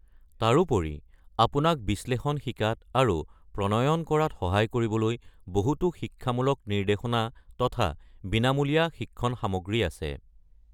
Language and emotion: Assamese, neutral